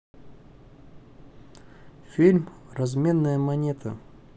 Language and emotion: Russian, neutral